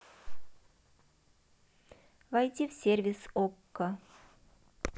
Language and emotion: Russian, neutral